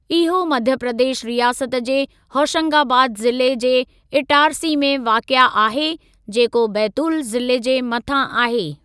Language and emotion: Sindhi, neutral